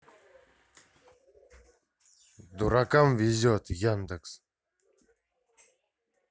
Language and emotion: Russian, angry